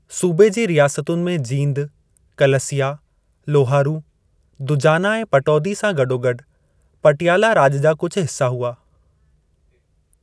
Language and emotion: Sindhi, neutral